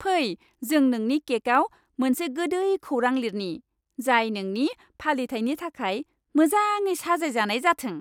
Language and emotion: Bodo, happy